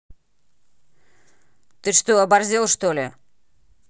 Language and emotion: Russian, angry